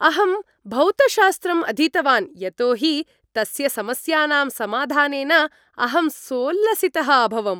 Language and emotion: Sanskrit, happy